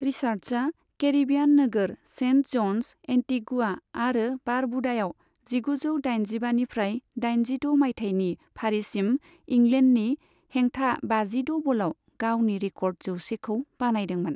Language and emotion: Bodo, neutral